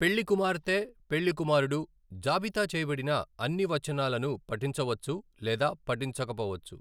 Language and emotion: Telugu, neutral